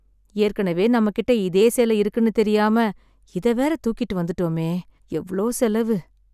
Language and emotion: Tamil, sad